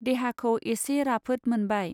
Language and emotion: Bodo, neutral